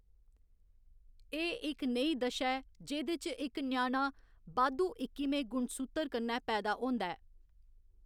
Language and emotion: Dogri, neutral